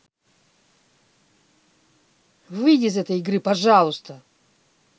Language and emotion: Russian, angry